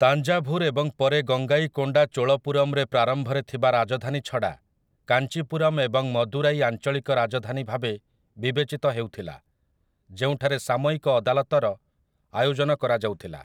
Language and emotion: Odia, neutral